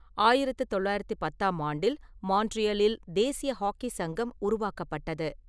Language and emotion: Tamil, neutral